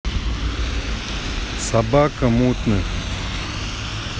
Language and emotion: Russian, neutral